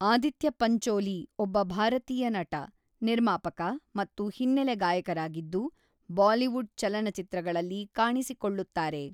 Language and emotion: Kannada, neutral